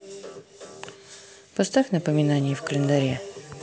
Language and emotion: Russian, neutral